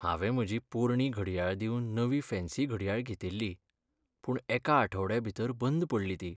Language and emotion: Goan Konkani, sad